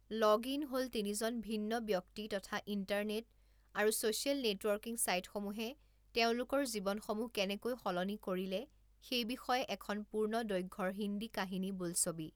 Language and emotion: Assamese, neutral